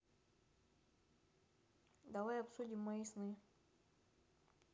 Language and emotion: Russian, neutral